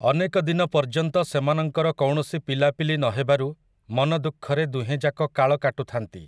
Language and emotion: Odia, neutral